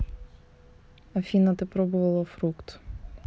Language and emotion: Russian, neutral